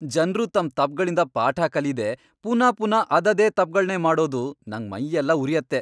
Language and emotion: Kannada, angry